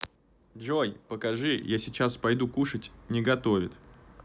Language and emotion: Russian, neutral